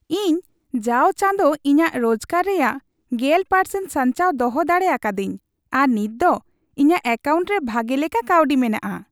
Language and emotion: Santali, happy